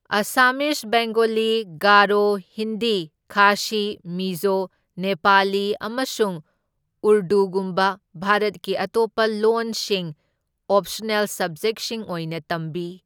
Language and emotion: Manipuri, neutral